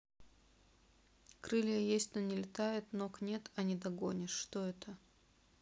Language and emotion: Russian, neutral